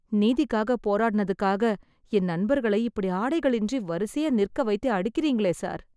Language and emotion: Tamil, sad